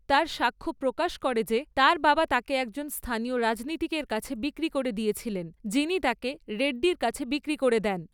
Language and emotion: Bengali, neutral